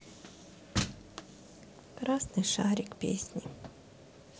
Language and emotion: Russian, sad